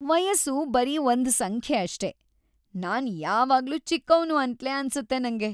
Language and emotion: Kannada, happy